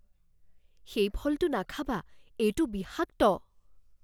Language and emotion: Assamese, fearful